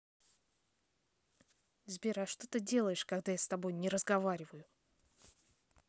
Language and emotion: Russian, angry